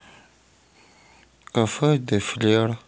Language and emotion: Russian, sad